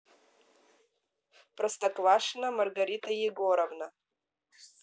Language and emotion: Russian, neutral